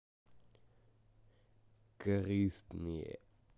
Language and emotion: Russian, angry